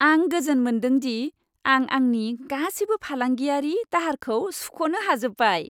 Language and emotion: Bodo, happy